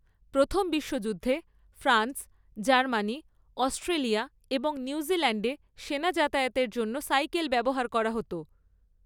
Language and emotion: Bengali, neutral